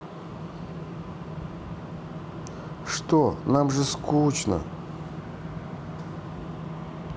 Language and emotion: Russian, sad